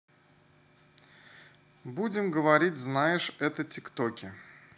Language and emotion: Russian, neutral